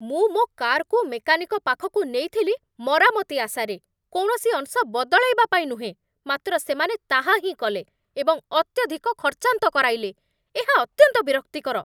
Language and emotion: Odia, angry